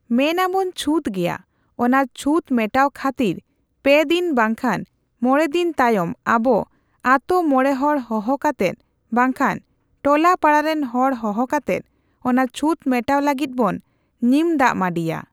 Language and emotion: Santali, neutral